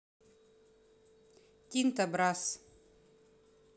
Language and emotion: Russian, neutral